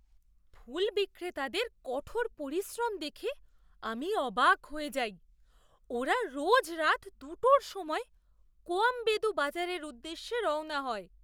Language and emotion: Bengali, surprised